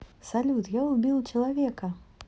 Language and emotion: Russian, positive